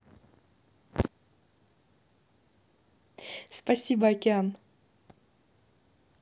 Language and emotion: Russian, positive